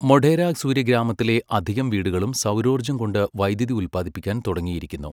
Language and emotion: Malayalam, neutral